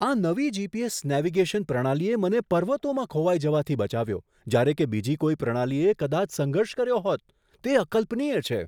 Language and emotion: Gujarati, surprised